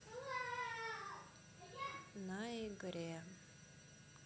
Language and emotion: Russian, neutral